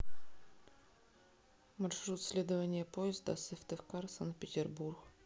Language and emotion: Russian, neutral